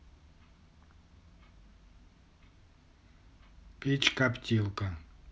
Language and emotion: Russian, neutral